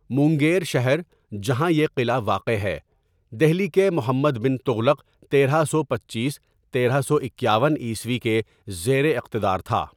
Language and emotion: Urdu, neutral